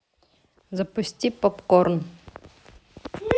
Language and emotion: Russian, neutral